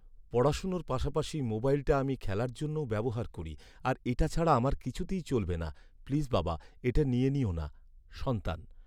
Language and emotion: Bengali, sad